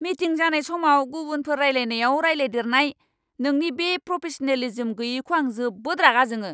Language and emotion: Bodo, angry